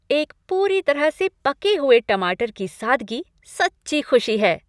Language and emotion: Hindi, happy